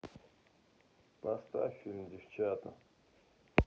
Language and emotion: Russian, sad